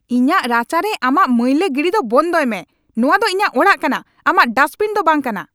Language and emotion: Santali, angry